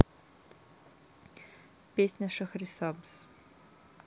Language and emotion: Russian, neutral